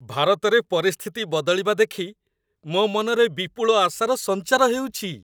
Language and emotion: Odia, happy